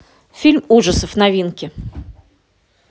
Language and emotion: Russian, neutral